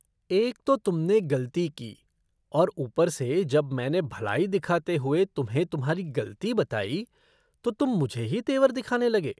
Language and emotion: Hindi, disgusted